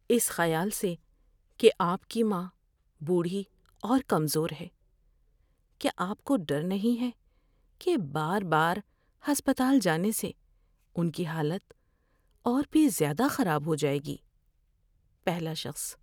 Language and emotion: Urdu, fearful